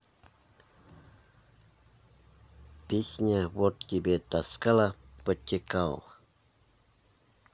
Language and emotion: Russian, neutral